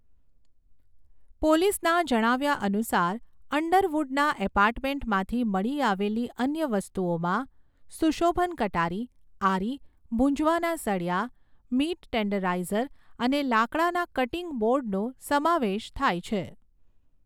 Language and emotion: Gujarati, neutral